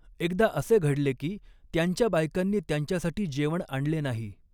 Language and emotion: Marathi, neutral